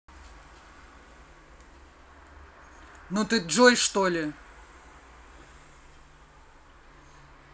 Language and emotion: Russian, angry